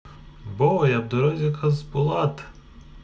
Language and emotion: Russian, positive